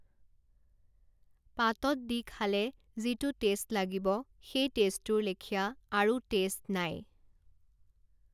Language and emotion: Assamese, neutral